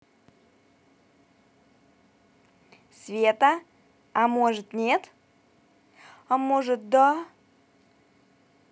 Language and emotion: Russian, positive